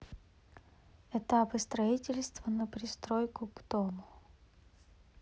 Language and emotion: Russian, neutral